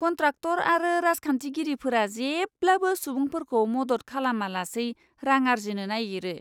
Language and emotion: Bodo, disgusted